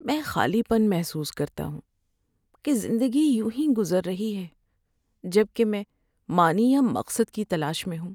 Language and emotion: Urdu, sad